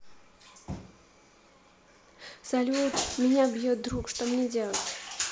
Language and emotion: Russian, neutral